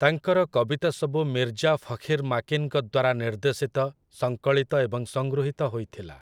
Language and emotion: Odia, neutral